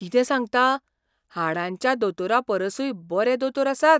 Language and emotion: Goan Konkani, surprised